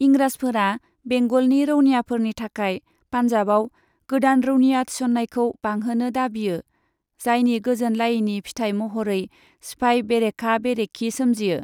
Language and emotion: Bodo, neutral